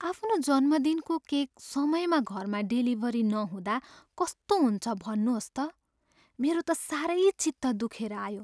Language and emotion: Nepali, sad